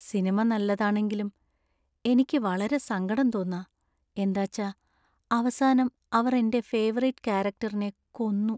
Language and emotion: Malayalam, sad